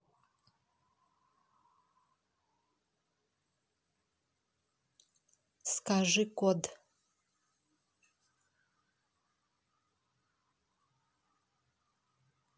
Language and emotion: Russian, neutral